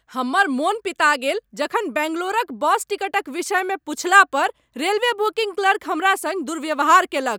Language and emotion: Maithili, angry